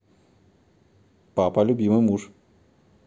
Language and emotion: Russian, positive